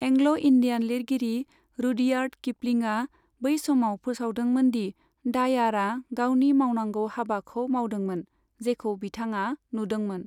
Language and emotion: Bodo, neutral